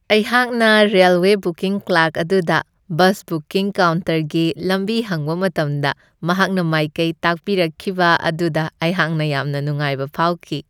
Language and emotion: Manipuri, happy